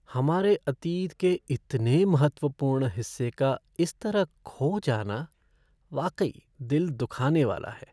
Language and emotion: Hindi, sad